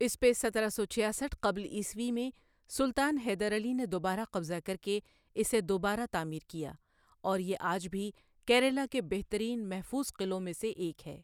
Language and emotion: Urdu, neutral